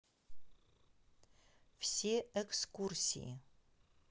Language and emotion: Russian, neutral